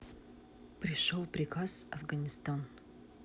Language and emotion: Russian, neutral